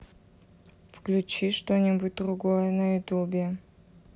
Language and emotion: Russian, neutral